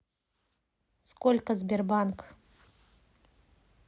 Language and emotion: Russian, neutral